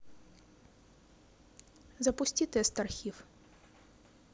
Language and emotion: Russian, neutral